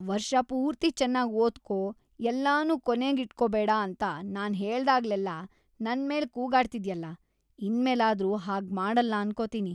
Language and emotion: Kannada, disgusted